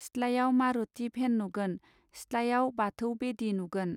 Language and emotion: Bodo, neutral